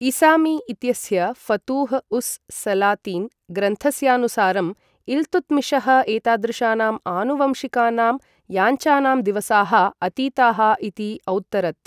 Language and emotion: Sanskrit, neutral